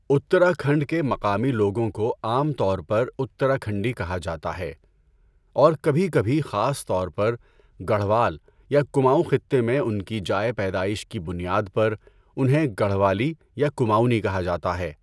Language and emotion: Urdu, neutral